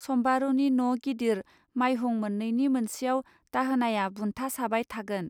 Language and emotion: Bodo, neutral